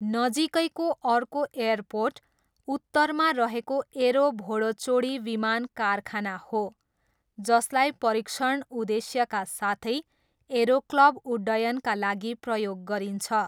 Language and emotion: Nepali, neutral